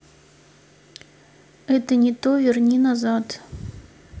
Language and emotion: Russian, neutral